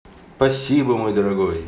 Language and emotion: Russian, positive